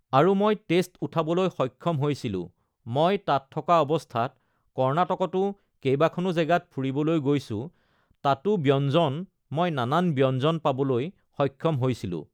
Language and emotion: Assamese, neutral